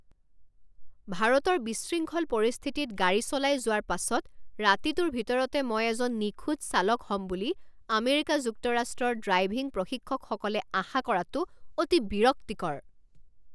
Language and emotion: Assamese, angry